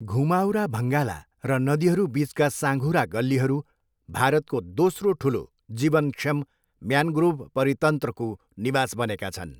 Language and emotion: Nepali, neutral